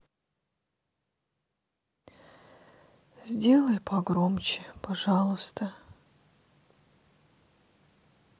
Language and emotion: Russian, sad